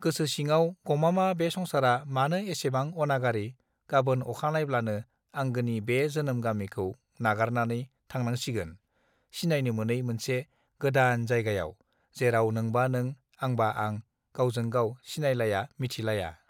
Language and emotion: Bodo, neutral